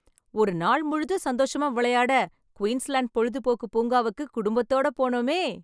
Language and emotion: Tamil, happy